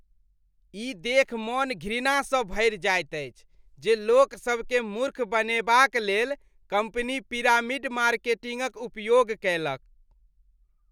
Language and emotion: Maithili, disgusted